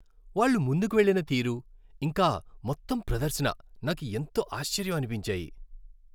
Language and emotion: Telugu, happy